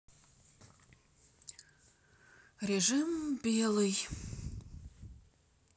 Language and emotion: Russian, sad